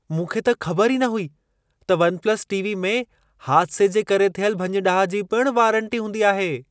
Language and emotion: Sindhi, surprised